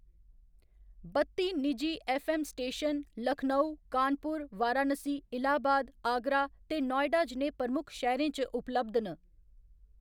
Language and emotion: Dogri, neutral